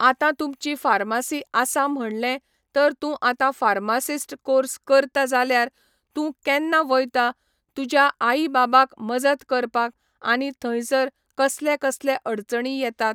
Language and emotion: Goan Konkani, neutral